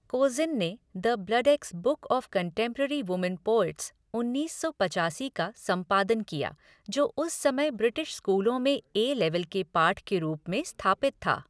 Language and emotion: Hindi, neutral